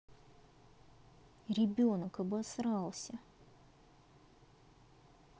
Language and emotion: Russian, neutral